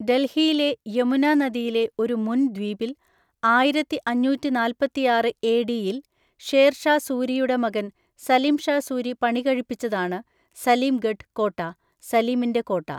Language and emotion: Malayalam, neutral